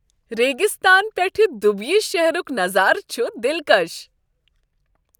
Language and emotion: Kashmiri, happy